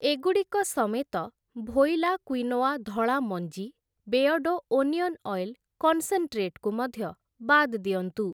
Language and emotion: Odia, neutral